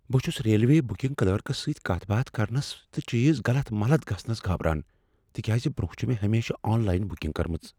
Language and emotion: Kashmiri, fearful